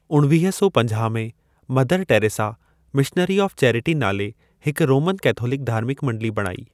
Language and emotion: Sindhi, neutral